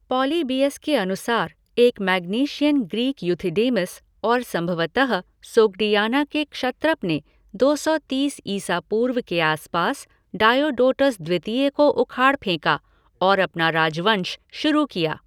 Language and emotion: Hindi, neutral